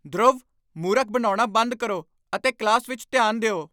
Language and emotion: Punjabi, angry